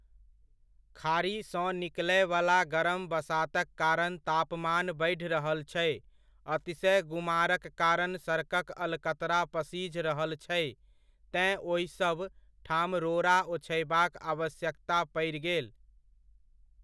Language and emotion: Maithili, neutral